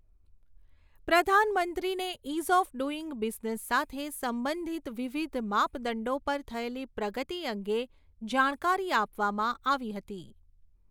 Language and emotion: Gujarati, neutral